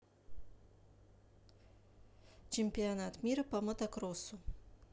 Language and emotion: Russian, neutral